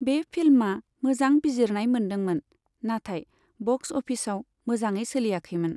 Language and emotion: Bodo, neutral